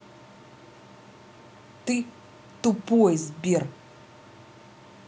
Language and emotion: Russian, angry